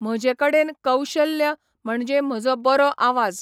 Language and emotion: Goan Konkani, neutral